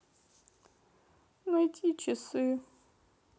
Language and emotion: Russian, sad